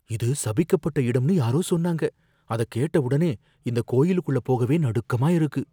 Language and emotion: Tamil, fearful